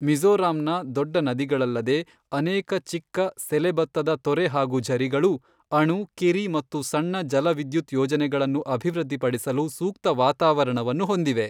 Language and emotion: Kannada, neutral